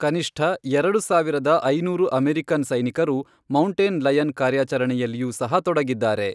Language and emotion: Kannada, neutral